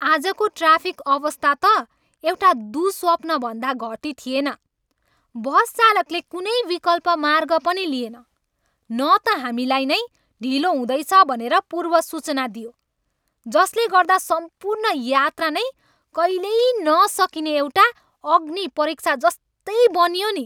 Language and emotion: Nepali, angry